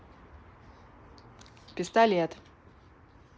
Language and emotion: Russian, neutral